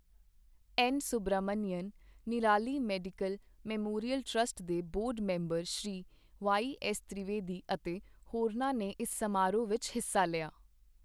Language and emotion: Punjabi, neutral